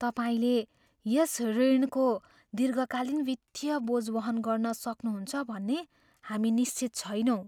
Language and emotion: Nepali, fearful